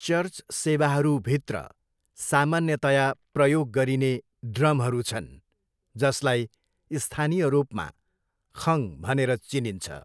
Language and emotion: Nepali, neutral